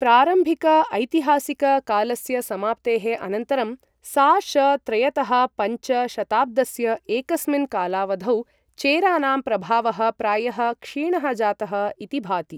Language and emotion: Sanskrit, neutral